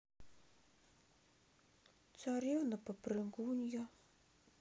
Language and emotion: Russian, sad